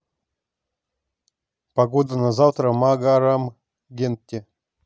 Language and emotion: Russian, neutral